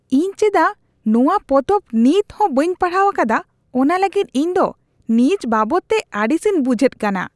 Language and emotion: Santali, disgusted